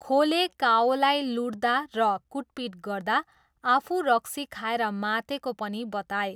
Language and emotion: Nepali, neutral